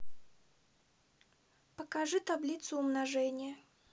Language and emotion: Russian, neutral